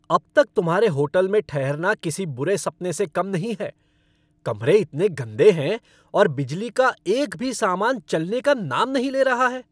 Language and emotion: Hindi, angry